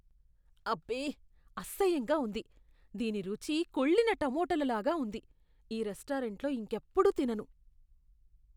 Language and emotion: Telugu, disgusted